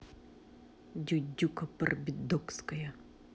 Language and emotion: Russian, angry